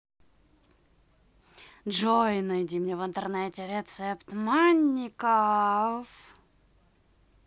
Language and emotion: Russian, positive